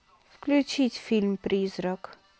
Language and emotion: Russian, neutral